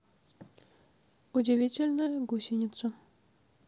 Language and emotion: Russian, neutral